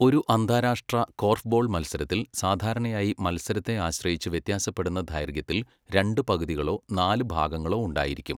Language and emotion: Malayalam, neutral